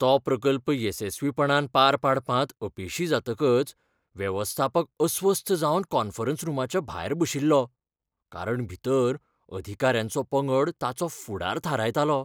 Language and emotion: Goan Konkani, fearful